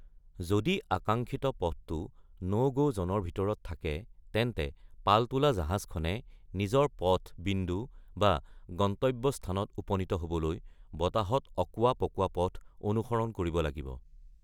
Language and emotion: Assamese, neutral